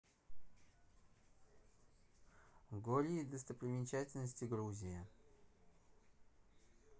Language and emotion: Russian, neutral